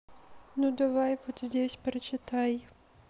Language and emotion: Russian, sad